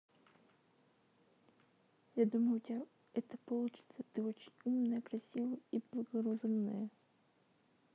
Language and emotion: Russian, neutral